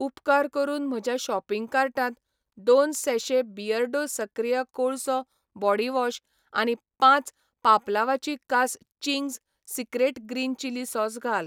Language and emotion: Goan Konkani, neutral